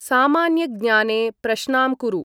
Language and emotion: Sanskrit, neutral